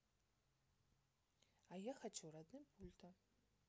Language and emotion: Russian, neutral